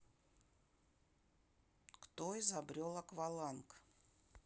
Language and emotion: Russian, neutral